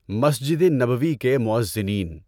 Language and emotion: Urdu, neutral